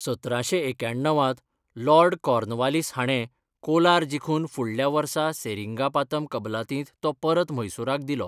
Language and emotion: Goan Konkani, neutral